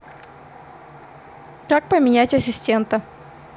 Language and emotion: Russian, neutral